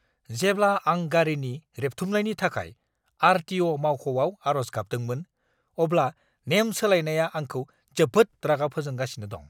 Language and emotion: Bodo, angry